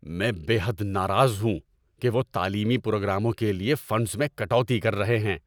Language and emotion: Urdu, angry